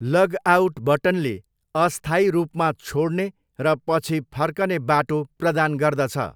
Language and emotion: Nepali, neutral